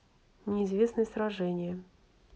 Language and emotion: Russian, neutral